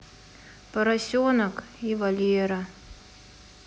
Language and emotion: Russian, sad